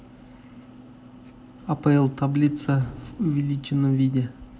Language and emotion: Russian, neutral